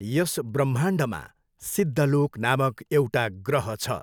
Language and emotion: Nepali, neutral